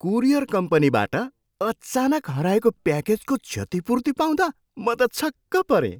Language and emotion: Nepali, surprised